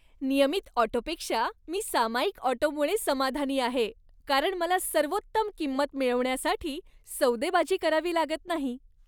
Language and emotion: Marathi, happy